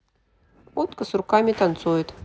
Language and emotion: Russian, neutral